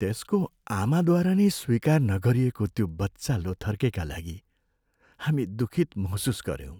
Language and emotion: Nepali, sad